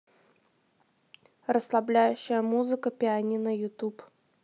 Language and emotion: Russian, neutral